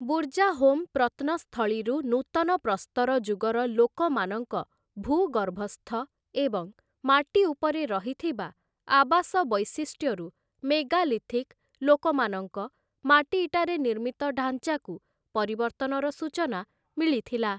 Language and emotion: Odia, neutral